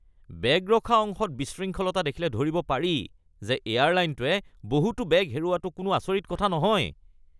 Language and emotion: Assamese, disgusted